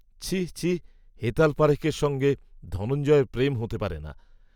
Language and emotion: Bengali, neutral